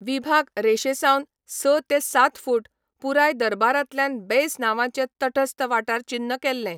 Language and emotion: Goan Konkani, neutral